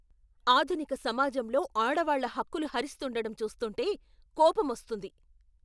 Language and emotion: Telugu, angry